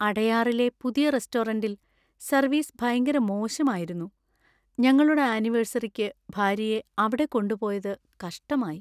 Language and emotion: Malayalam, sad